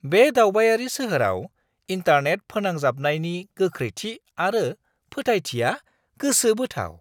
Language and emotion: Bodo, surprised